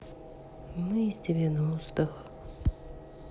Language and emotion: Russian, sad